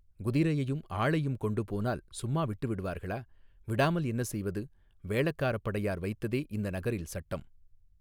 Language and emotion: Tamil, neutral